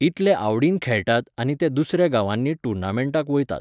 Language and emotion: Goan Konkani, neutral